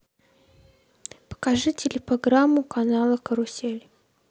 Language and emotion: Russian, neutral